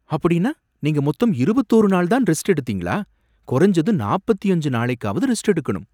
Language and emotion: Tamil, surprised